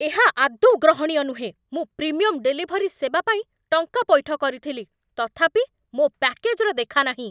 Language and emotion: Odia, angry